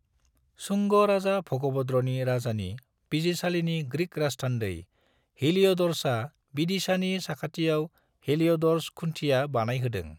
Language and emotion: Bodo, neutral